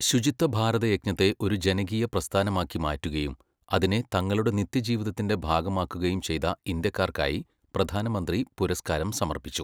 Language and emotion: Malayalam, neutral